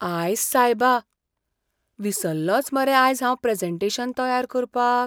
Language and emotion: Goan Konkani, fearful